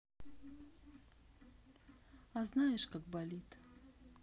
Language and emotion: Russian, sad